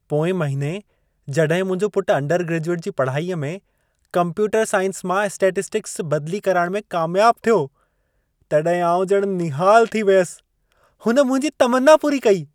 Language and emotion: Sindhi, happy